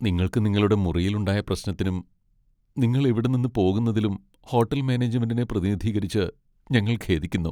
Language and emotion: Malayalam, sad